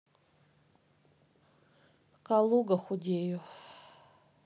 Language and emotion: Russian, neutral